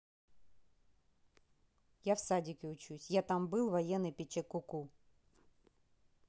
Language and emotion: Russian, neutral